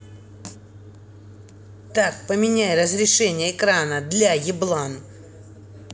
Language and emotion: Russian, angry